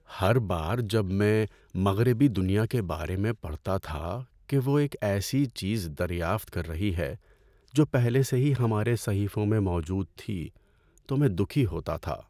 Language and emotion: Urdu, sad